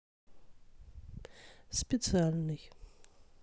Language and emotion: Russian, neutral